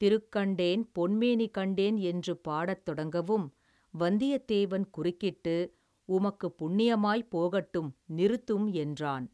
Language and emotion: Tamil, neutral